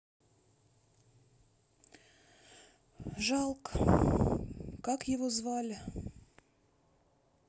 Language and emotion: Russian, sad